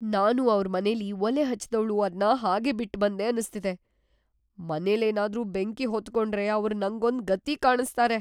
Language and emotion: Kannada, fearful